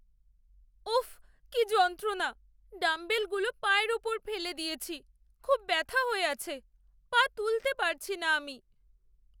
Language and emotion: Bengali, sad